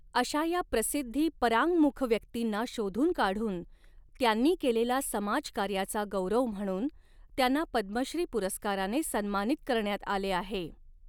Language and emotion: Marathi, neutral